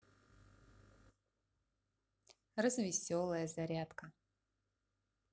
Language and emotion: Russian, positive